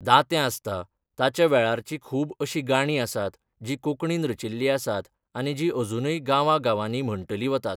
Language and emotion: Goan Konkani, neutral